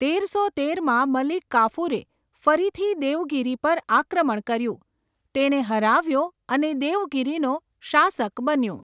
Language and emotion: Gujarati, neutral